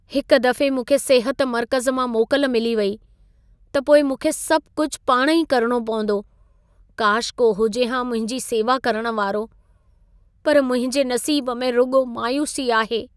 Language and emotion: Sindhi, sad